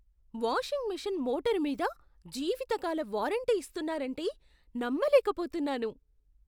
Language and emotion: Telugu, surprised